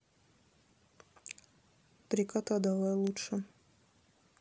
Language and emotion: Russian, neutral